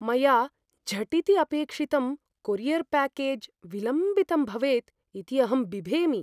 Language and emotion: Sanskrit, fearful